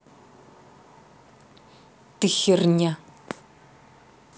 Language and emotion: Russian, angry